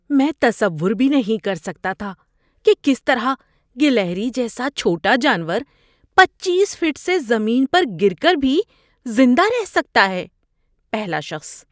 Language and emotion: Urdu, surprised